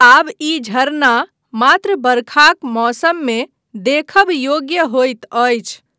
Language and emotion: Maithili, neutral